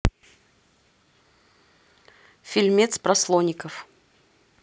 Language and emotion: Russian, neutral